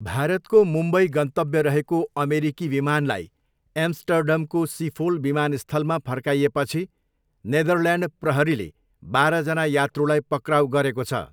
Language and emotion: Nepali, neutral